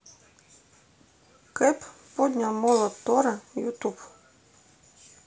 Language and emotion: Russian, neutral